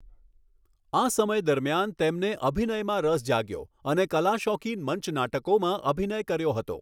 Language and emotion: Gujarati, neutral